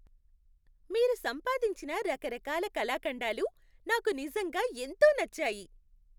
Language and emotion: Telugu, happy